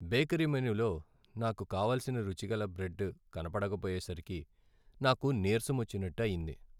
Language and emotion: Telugu, sad